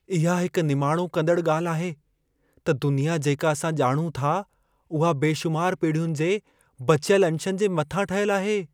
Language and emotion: Sindhi, fearful